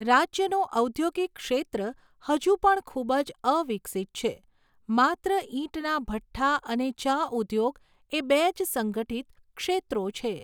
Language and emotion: Gujarati, neutral